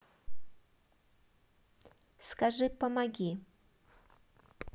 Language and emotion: Russian, neutral